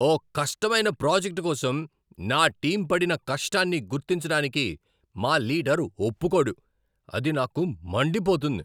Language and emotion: Telugu, angry